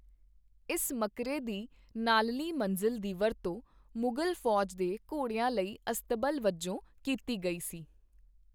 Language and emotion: Punjabi, neutral